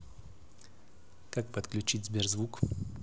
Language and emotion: Russian, neutral